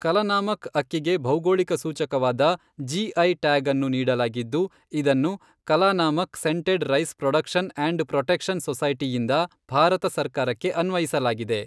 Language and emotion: Kannada, neutral